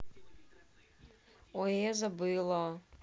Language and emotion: Russian, sad